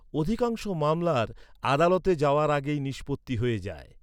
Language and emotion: Bengali, neutral